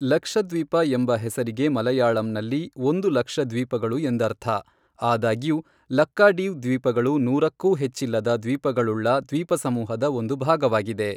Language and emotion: Kannada, neutral